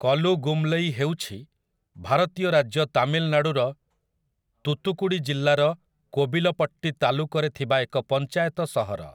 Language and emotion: Odia, neutral